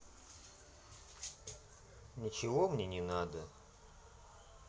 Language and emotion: Russian, sad